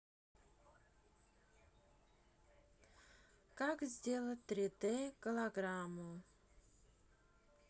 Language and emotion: Russian, sad